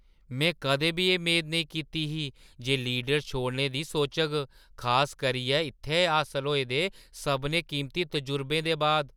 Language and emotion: Dogri, surprised